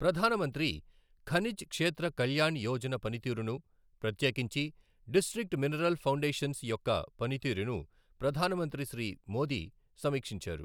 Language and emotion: Telugu, neutral